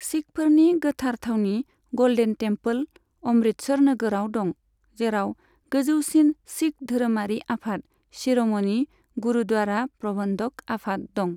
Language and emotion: Bodo, neutral